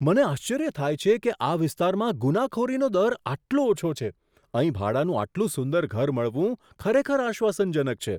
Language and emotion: Gujarati, surprised